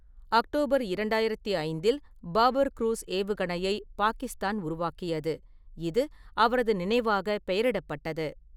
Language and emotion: Tamil, neutral